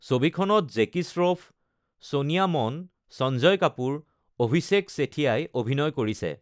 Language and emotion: Assamese, neutral